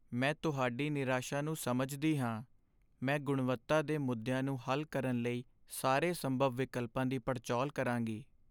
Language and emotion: Punjabi, sad